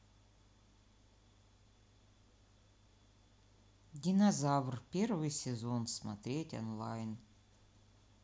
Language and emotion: Russian, neutral